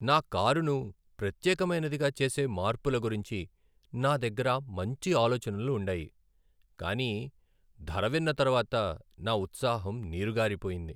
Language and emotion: Telugu, sad